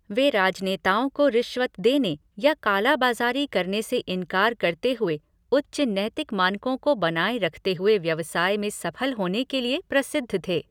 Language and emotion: Hindi, neutral